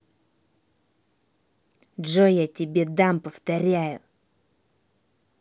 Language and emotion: Russian, angry